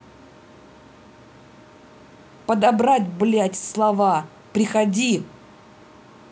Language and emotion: Russian, angry